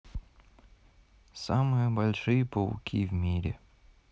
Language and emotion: Russian, sad